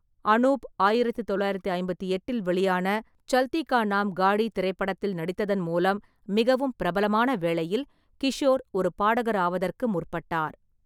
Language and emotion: Tamil, neutral